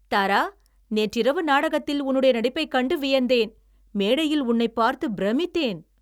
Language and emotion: Tamil, happy